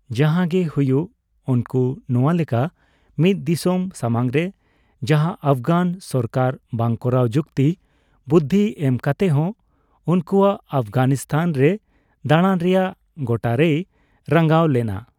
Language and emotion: Santali, neutral